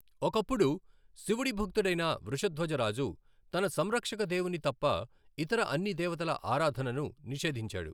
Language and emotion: Telugu, neutral